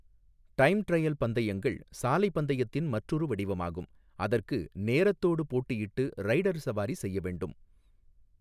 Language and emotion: Tamil, neutral